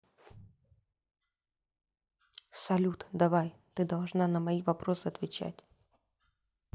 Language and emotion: Russian, neutral